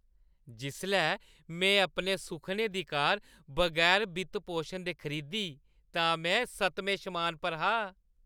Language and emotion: Dogri, happy